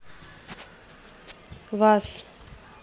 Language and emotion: Russian, neutral